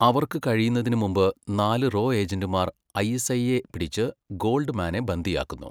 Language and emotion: Malayalam, neutral